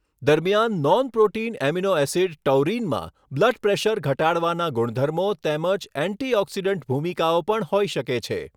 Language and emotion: Gujarati, neutral